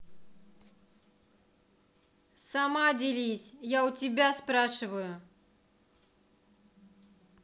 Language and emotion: Russian, angry